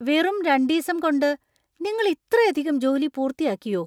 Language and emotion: Malayalam, surprised